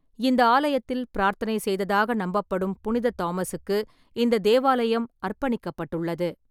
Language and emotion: Tamil, neutral